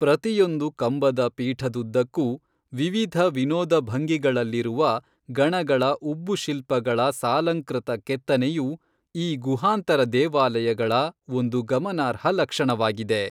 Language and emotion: Kannada, neutral